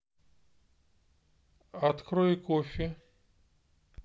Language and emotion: Russian, neutral